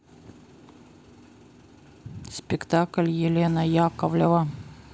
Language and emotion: Russian, neutral